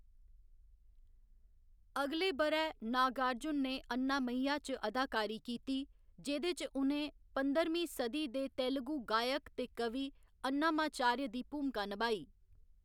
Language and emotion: Dogri, neutral